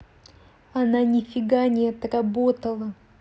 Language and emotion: Russian, angry